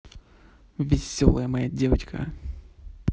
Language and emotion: Russian, positive